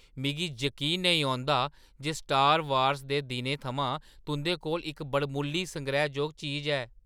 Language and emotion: Dogri, surprised